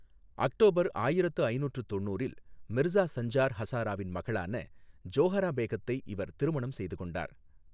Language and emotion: Tamil, neutral